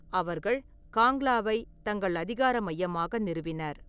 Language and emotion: Tamil, neutral